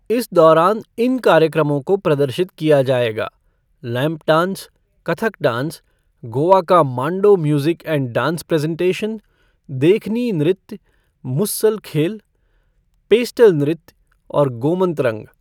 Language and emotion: Hindi, neutral